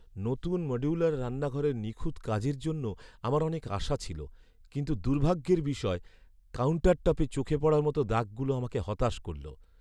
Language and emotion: Bengali, sad